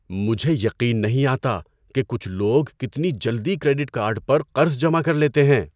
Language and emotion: Urdu, surprised